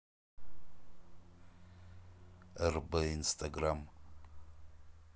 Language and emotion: Russian, neutral